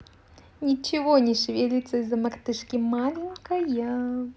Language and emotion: Russian, positive